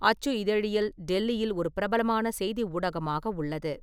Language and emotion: Tamil, neutral